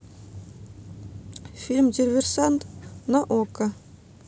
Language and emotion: Russian, neutral